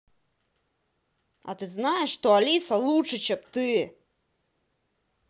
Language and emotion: Russian, angry